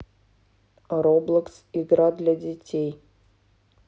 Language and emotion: Russian, neutral